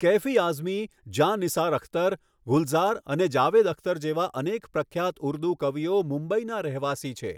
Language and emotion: Gujarati, neutral